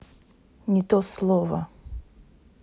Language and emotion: Russian, neutral